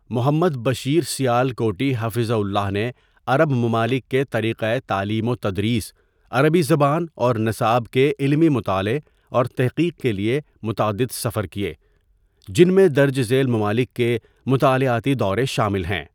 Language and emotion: Urdu, neutral